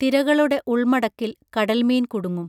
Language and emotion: Malayalam, neutral